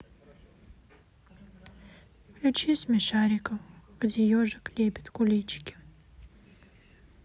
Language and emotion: Russian, sad